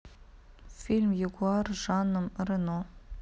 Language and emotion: Russian, neutral